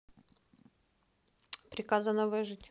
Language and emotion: Russian, neutral